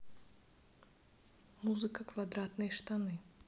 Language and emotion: Russian, neutral